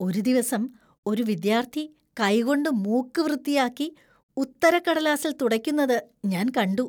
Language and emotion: Malayalam, disgusted